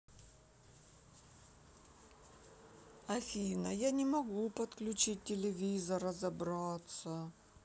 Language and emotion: Russian, sad